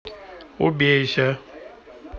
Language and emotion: Russian, neutral